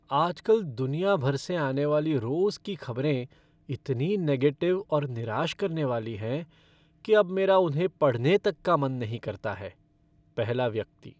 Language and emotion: Hindi, sad